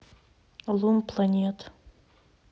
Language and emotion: Russian, neutral